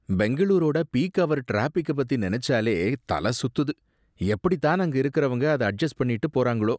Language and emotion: Tamil, disgusted